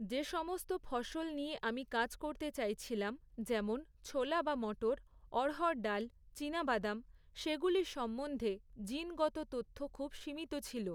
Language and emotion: Bengali, neutral